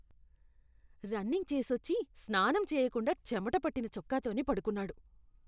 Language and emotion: Telugu, disgusted